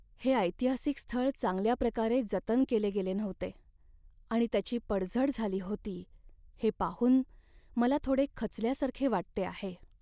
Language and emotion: Marathi, sad